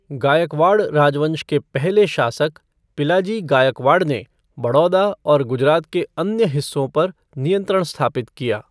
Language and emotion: Hindi, neutral